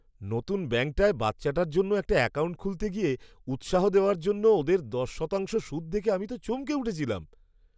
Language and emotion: Bengali, surprised